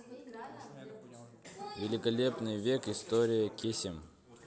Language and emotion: Russian, neutral